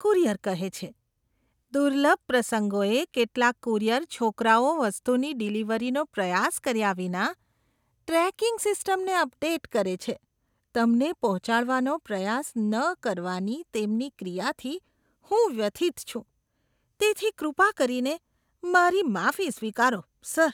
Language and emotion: Gujarati, disgusted